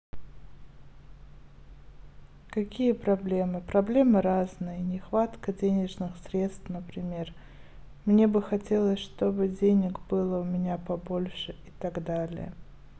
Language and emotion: Russian, neutral